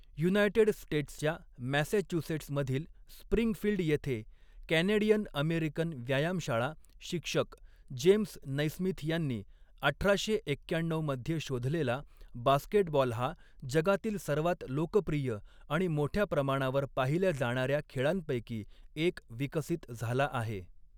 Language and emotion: Marathi, neutral